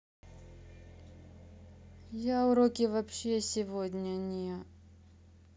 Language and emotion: Russian, sad